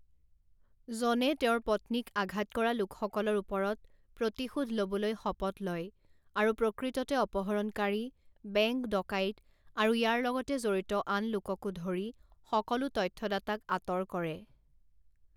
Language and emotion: Assamese, neutral